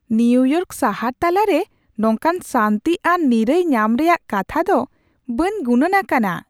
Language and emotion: Santali, surprised